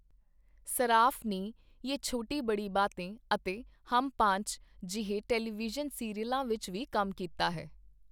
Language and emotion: Punjabi, neutral